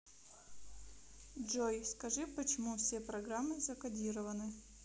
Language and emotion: Russian, neutral